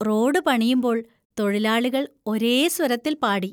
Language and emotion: Malayalam, happy